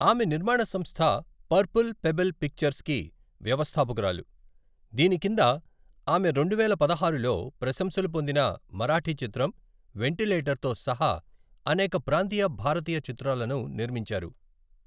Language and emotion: Telugu, neutral